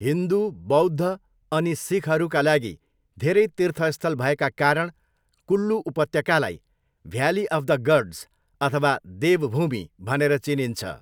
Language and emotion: Nepali, neutral